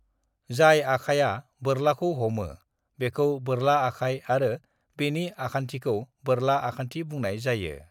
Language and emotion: Bodo, neutral